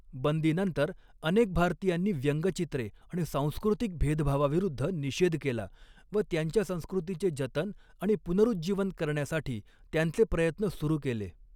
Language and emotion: Marathi, neutral